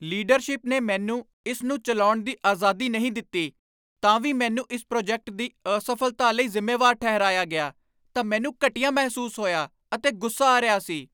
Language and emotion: Punjabi, angry